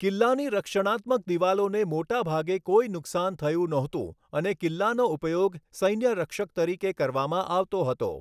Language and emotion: Gujarati, neutral